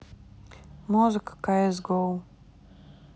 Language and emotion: Russian, neutral